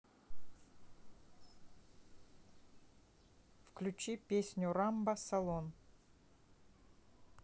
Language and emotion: Russian, neutral